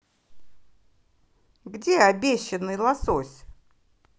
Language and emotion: Russian, angry